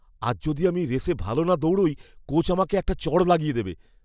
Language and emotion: Bengali, fearful